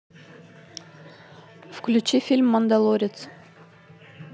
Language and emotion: Russian, neutral